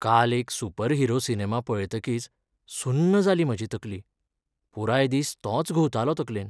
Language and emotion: Goan Konkani, sad